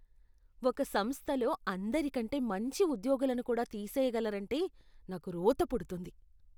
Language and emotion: Telugu, disgusted